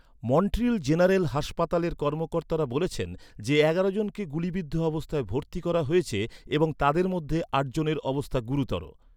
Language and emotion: Bengali, neutral